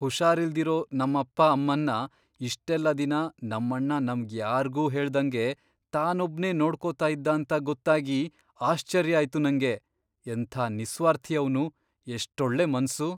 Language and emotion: Kannada, surprised